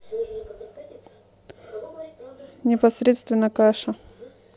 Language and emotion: Russian, neutral